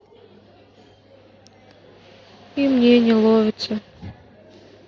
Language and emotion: Russian, sad